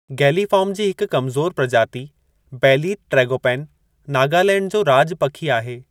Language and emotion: Sindhi, neutral